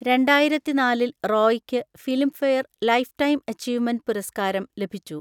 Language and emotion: Malayalam, neutral